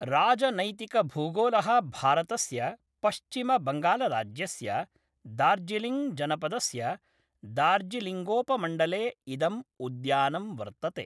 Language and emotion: Sanskrit, neutral